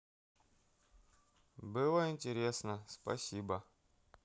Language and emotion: Russian, neutral